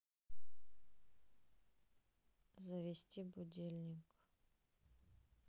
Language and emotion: Russian, neutral